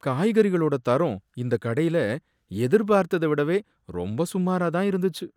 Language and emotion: Tamil, sad